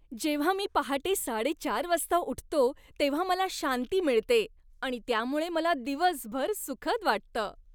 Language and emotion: Marathi, happy